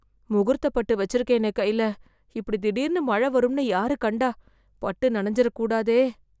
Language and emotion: Tamil, fearful